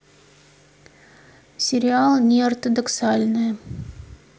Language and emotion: Russian, neutral